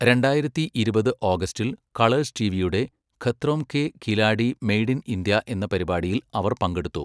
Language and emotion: Malayalam, neutral